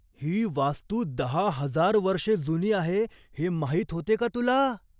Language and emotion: Marathi, surprised